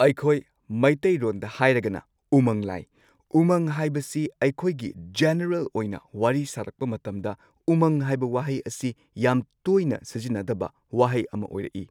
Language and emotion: Manipuri, neutral